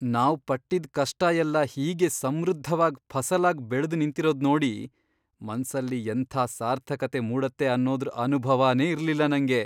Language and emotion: Kannada, surprised